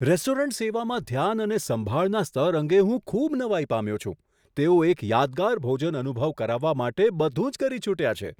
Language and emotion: Gujarati, surprised